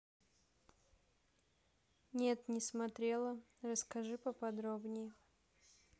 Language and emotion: Russian, neutral